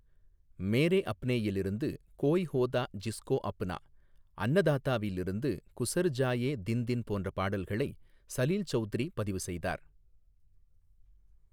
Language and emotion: Tamil, neutral